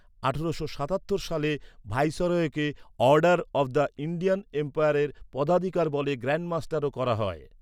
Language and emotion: Bengali, neutral